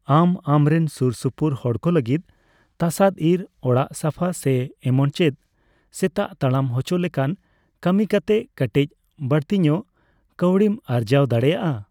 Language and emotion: Santali, neutral